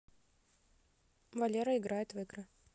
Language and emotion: Russian, neutral